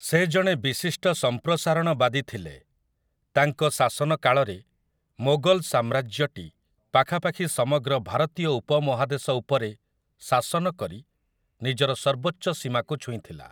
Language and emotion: Odia, neutral